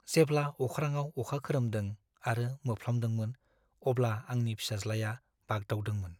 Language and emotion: Bodo, fearful